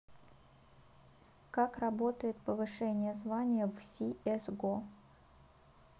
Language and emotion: Russian, neutral